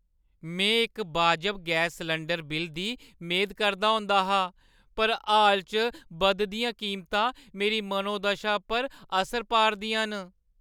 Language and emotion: Dogri, sad